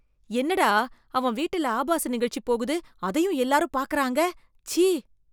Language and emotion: Tamil, disgusted